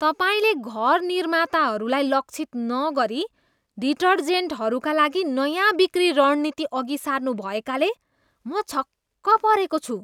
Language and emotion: Nepali, disgusted